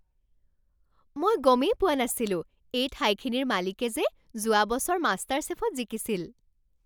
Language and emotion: Assamese, surprised